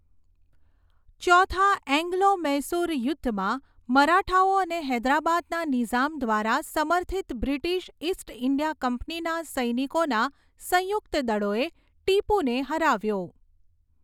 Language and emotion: Gujarati, neutral